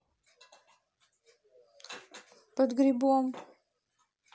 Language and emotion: Russian, neutral